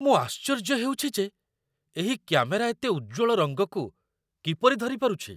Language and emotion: Odia, surprised